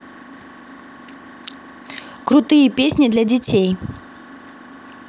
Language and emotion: Russian, positive